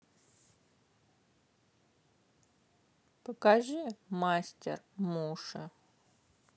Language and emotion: Russian, neutral